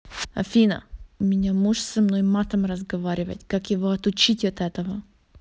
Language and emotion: Russian, neutral